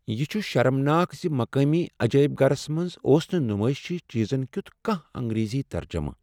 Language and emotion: Kashmiri, sad